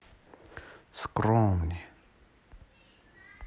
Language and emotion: Russian, neutral